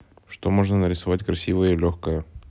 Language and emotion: Russian, neutral